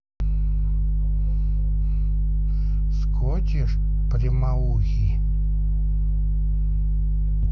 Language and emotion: Russian, neutral